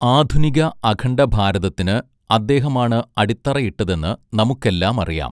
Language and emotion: Malayalam, neutral